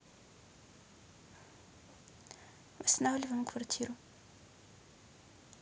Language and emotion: Russian, neutral